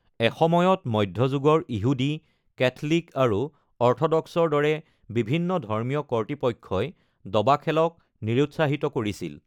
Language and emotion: Assamese, neutral